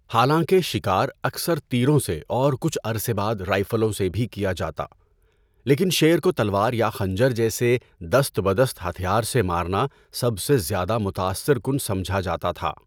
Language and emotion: Urdu, neutral